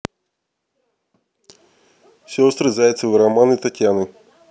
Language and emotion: Russian, neutral